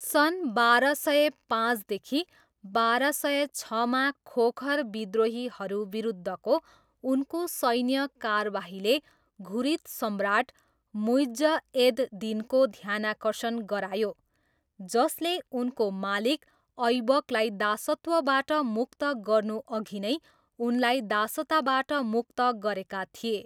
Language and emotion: Nepali, neutral